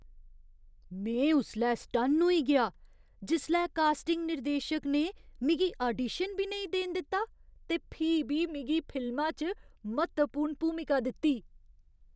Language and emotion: Dogri, surprised